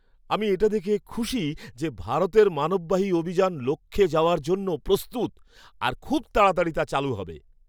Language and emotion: Bengali, happy